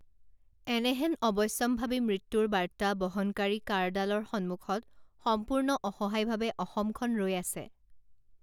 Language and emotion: Assamese, neutral